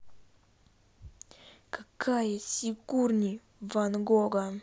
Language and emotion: Russian, angry